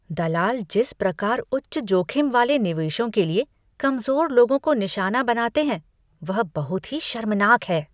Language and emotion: Hindi, disgusted